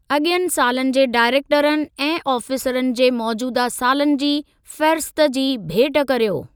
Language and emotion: Sindhi, neutral